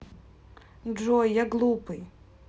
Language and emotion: Russian, sad